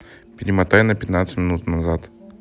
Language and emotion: Russian, neutral